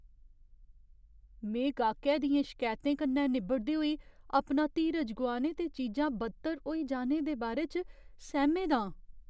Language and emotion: Dogri, fearful